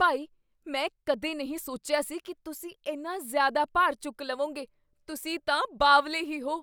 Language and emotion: Punjabi, surprised